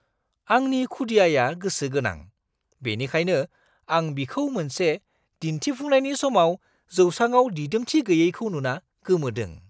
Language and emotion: Bodo, surprised